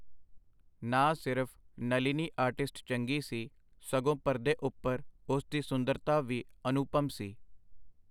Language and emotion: Punjabi, neutral